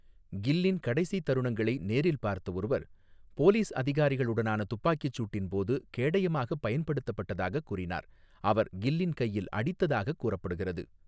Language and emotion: Tamil, neutral